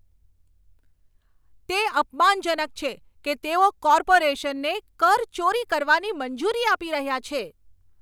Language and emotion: Gujarati, angry